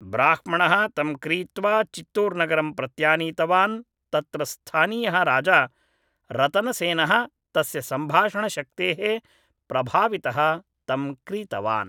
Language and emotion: Sanskrit, neutral